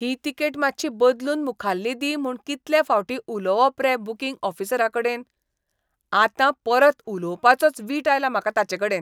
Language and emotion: Goan Konkani, disgusted